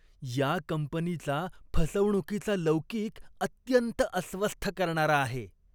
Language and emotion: Marathi, disgusted